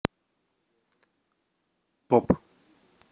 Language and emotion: Russian, neutral